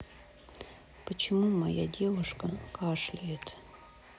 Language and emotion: Russian, sad